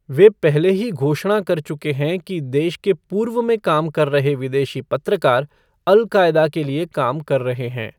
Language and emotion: Hindi, neutral